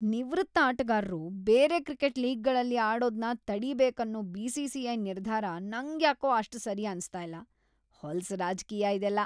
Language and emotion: Kannada, disgusted